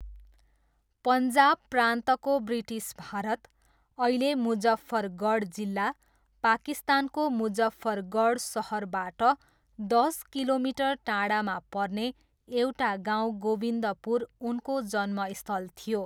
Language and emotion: Nepali, neutral